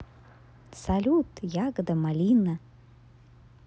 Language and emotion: Russian, positive